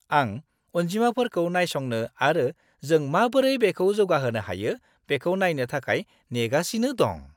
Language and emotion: Bodo, happy